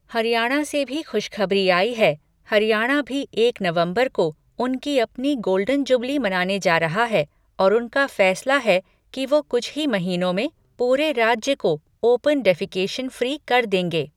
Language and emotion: Hindi, neutral